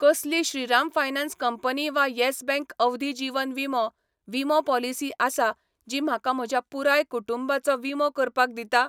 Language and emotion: Goan Konkani, neutral